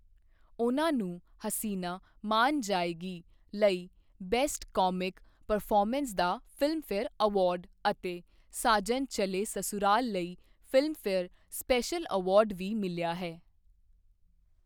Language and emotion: Punjabi, neutral